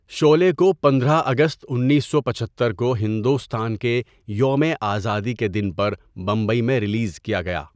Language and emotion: Urdu, neutral